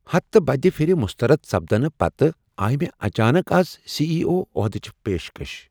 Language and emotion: Kashmiri, surprised